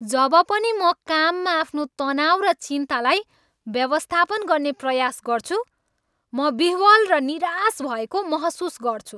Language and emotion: Nepali, angry